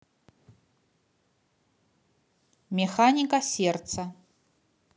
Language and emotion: Russian, neutral